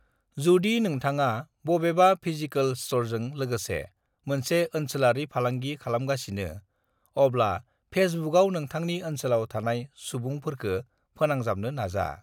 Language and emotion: Bodo, neutral